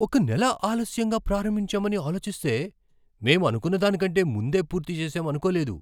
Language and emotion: Telugu, surprised